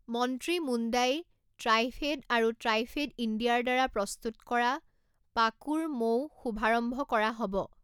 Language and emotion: Assamese, neutral